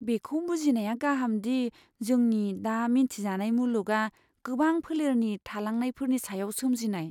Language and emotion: Bodo, fearful